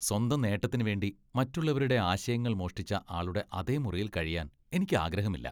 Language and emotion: Malayalam, disgusted